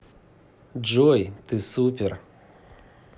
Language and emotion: Russian, positive